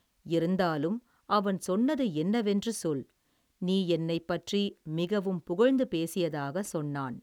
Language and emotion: Tamil, neutral